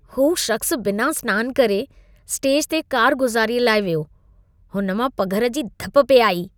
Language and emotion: Sindhi, disgusted